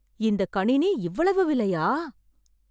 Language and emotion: Tamil, surprised